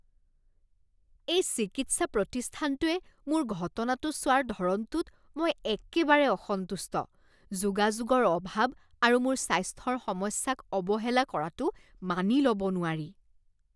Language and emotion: Assamese, disgusted